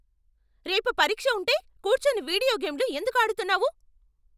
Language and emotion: Telugu, angry